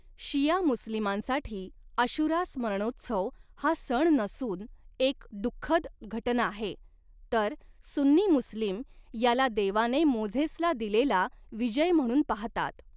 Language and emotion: Marathi, neutral